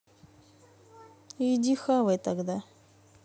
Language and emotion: Russian, neutral